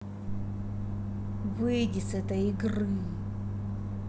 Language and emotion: Russian, angry